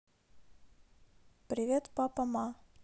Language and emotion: Russian, neutral